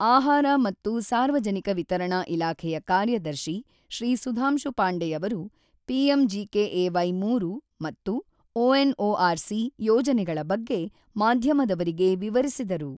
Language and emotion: Kannada, neutral